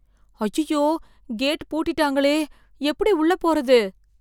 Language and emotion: Tamil, fearful